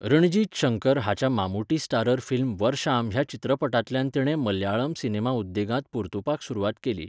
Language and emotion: Goan Konkani, neutral